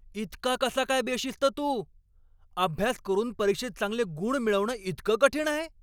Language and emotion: Marathi, angry